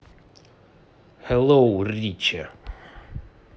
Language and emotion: Russian, positive